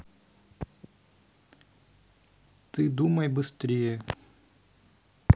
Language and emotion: Russian, neutral